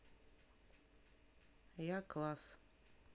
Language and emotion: Russian, neutral